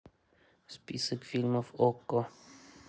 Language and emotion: Russian, neutral